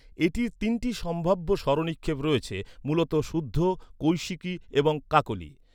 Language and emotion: Bengali, neutral